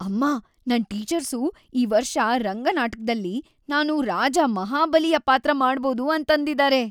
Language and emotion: Kannada, happy